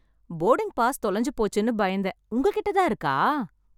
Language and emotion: Tamil, happy